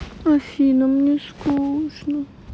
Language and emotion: Russian, sad